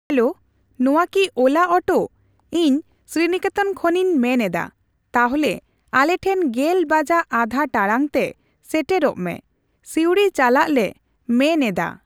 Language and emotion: Santali, neutral